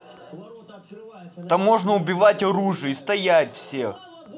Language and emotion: Russian, angry